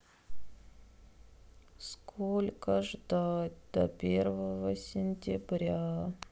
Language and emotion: Russian, sad